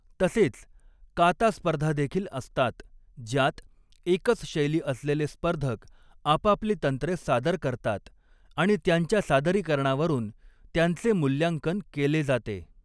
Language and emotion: Marathi, neutral